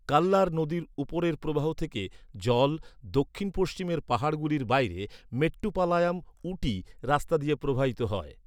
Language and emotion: Bengali, neutral